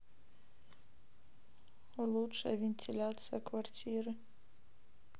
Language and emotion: Russian, neutral